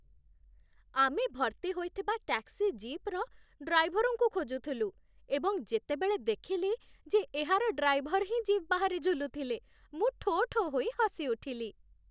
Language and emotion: Odia, happy